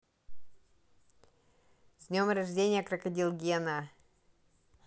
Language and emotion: Russian, positive